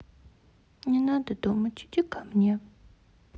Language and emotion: Russian, sad